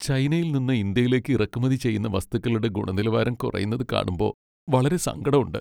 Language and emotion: Malayalam, sad